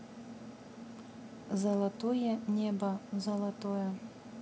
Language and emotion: Russian, neutral